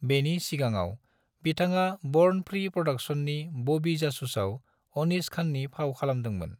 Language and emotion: Bodo, neutral